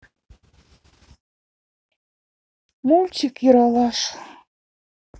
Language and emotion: Russian, sad